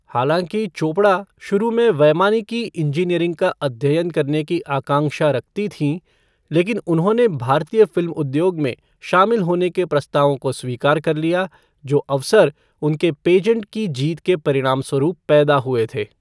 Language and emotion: Hindi, neutral